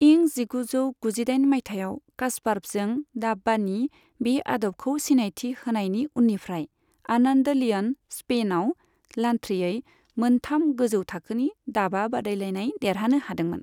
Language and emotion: Bodo, neutral